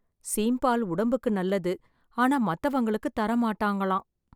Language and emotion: Tamil, sad